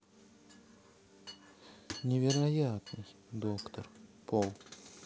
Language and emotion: Russian, sad